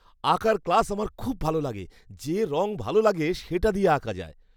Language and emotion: Bengali, happy